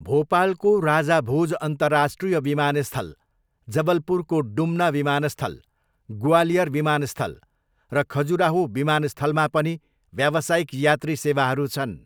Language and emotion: Nepali, neutral